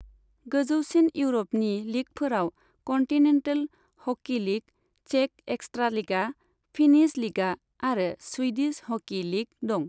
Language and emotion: Bodo, neutral